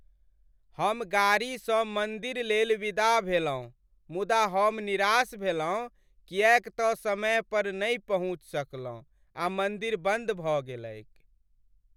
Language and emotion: Maithili, sad